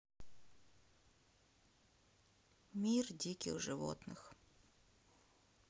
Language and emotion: Russian, sad